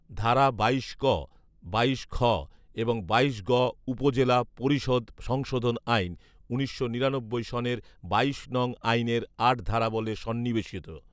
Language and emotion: Bengali, neutral